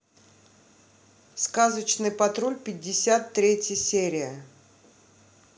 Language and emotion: Russian, neutral